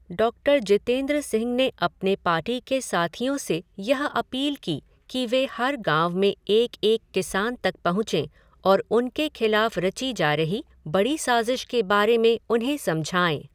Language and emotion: Hindi, neutral